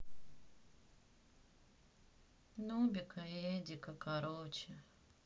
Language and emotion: Russian, sad